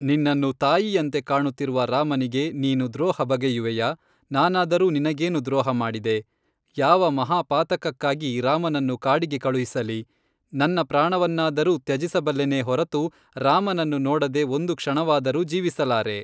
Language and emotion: Kannada, neutral